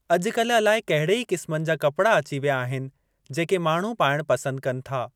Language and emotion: Sindhi, neutral